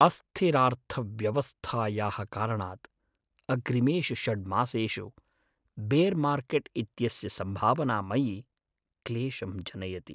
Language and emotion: Sanskrit, sad